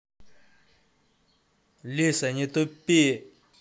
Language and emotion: Russian, angry